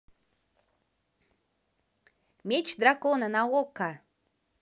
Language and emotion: Russian, positive